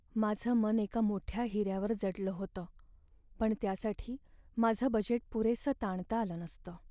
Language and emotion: Marathi, sad